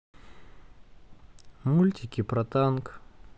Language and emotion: Russian, neutral